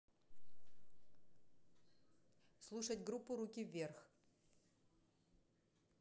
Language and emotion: Russian, neutral